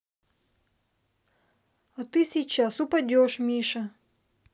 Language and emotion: Russian, neutral